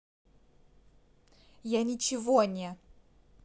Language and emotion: Russian, angry